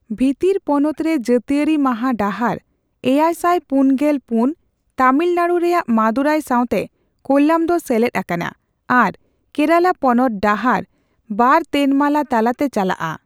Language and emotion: Santali, neutral